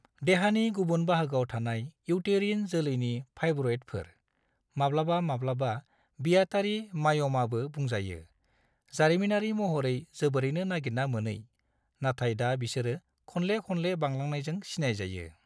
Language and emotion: Bodo, neutral